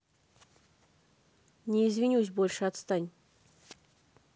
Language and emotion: Russian, angry